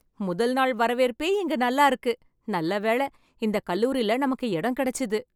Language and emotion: Tamil, happy